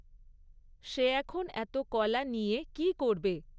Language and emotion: Bengali, neutral